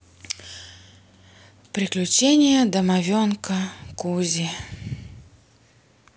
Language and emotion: Russian, sad